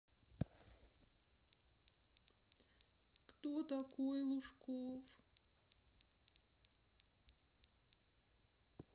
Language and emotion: Russian, sad